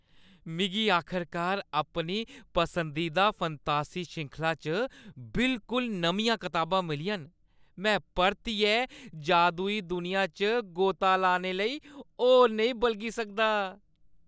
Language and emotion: Dogri, happy